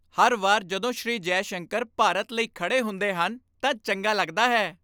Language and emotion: Punjabi, happy